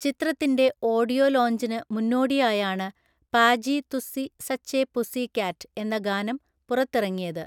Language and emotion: Malayalam, neutral